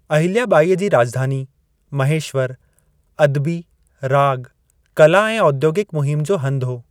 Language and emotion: Sindhi, neutral